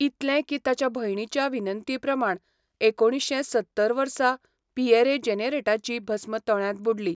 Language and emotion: Goan Konkani, neutral